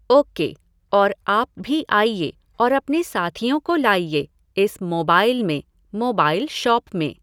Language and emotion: Hindi, neutral